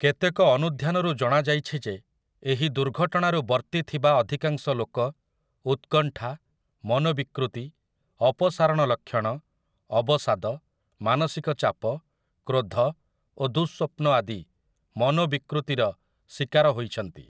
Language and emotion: Odia, neutral